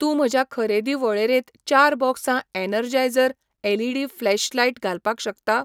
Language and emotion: Goan Konkani, neutral